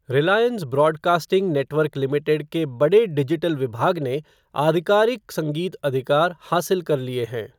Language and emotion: Hindi, neutral